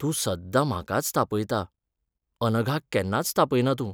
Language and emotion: Goan Konkani, sad